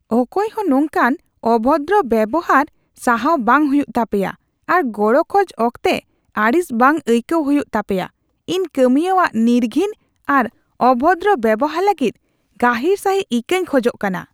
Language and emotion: Santali, disgusted